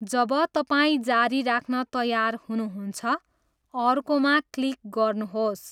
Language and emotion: Nepali, neutral